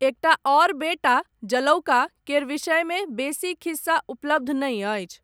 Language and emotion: Maithili, neutral